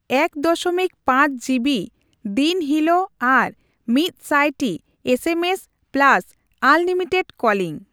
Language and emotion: Santali, neutral